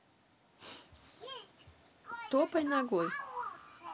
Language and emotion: Russian, neutral